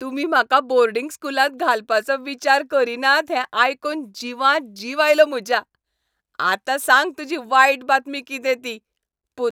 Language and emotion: Goan Konkani, happy